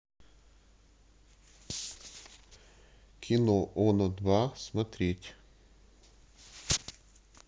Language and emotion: Russian, neutral